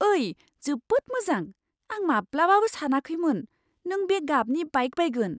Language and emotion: Bodo, surprised